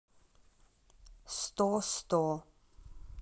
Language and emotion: Russian, neutral